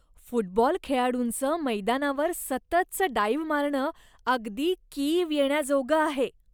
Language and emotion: Marathi, disgusted